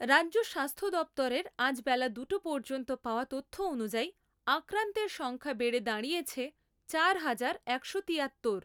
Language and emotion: Bengali, neutral